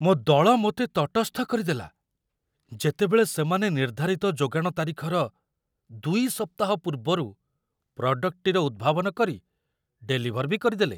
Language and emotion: Odia, surprised